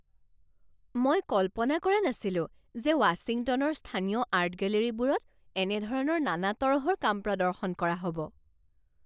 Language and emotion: Assamese, surprised